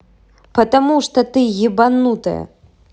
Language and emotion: Russian, angry